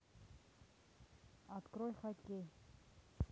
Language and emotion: Russian, neutral